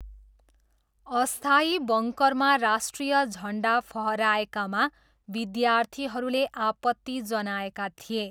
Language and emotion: Nepali, neutral